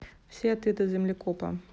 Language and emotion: Russian, neutral